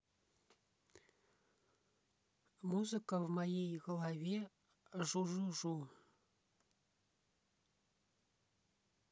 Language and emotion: Russian, neutral